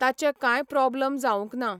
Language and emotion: Goan Konkani, neutral